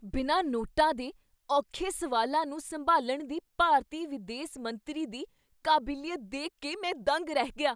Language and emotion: Punjabi, surprised